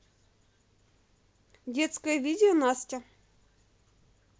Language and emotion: Russian, positive